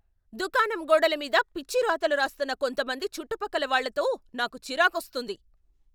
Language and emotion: Telugu, angry